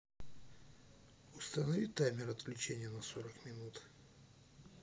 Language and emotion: Russian, neutral